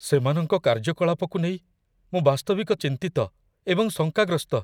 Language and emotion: Odia, fearful